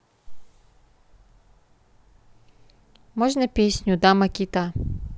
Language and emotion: Russian, neutral